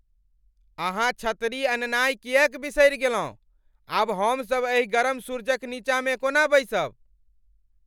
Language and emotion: Maithili, angry